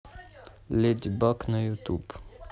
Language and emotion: Russian, neutral